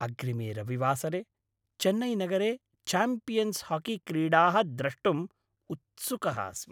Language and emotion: Sanskrit, happy